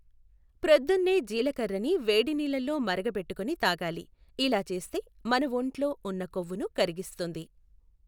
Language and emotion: Telugu, neutral